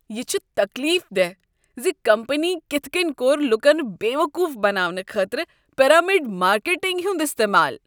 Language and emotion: Kashmiri, disgusted